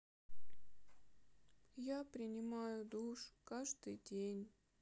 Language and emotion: Russian, sad